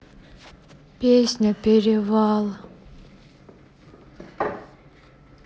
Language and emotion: Russian, sad